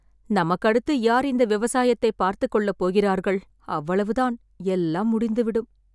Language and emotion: Tamil, sad